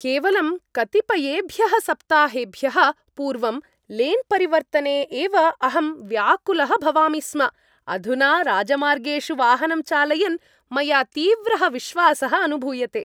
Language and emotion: Sanskrit, happy